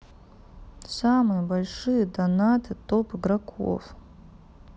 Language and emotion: Russian, sad